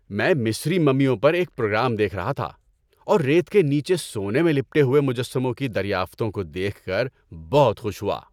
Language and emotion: Urdu, happy